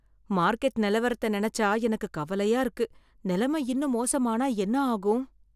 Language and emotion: Tamil, fearful